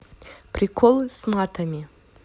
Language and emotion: Russian, positive